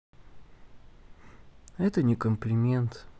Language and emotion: Russian, sad